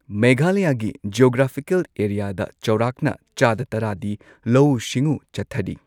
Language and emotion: Manipuri, neutral